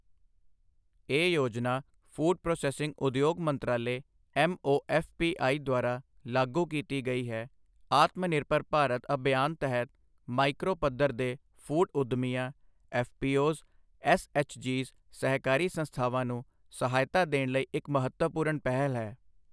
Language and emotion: Punjabi, neutral